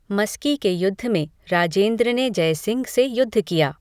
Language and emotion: Hindi, neutral